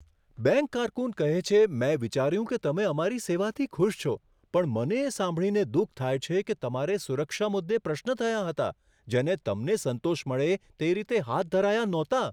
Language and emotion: Gujarati, surprised